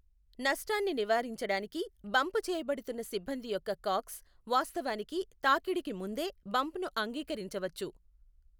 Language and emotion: Telugu, neutral